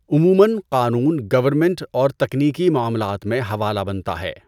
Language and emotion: Urdu, neutral